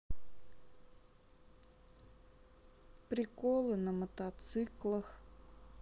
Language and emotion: Russian, neutral